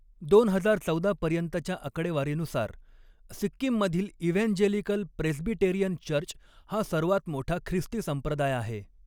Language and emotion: Marathi, neutral